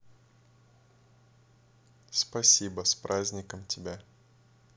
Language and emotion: Russian, neutral